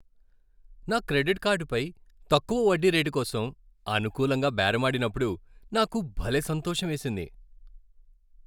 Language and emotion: Telugu, happy